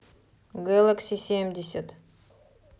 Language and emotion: Russian, neutral